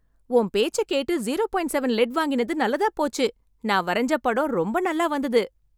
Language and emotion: Tamil, happy